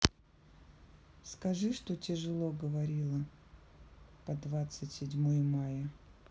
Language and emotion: Russian, neutral